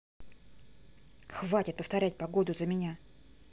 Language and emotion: Russian, angry